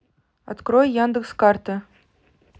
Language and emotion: Russian, neutral